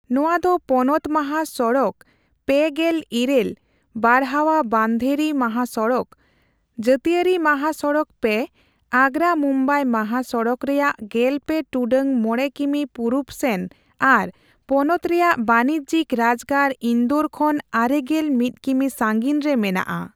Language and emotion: Santali, neutral